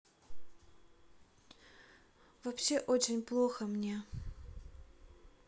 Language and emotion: Russian, sad